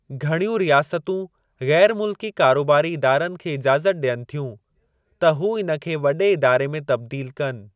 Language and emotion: Sindhi, neutral